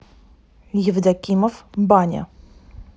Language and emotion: Russian, neutral